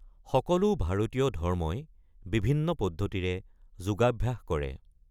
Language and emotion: Assamese, neutral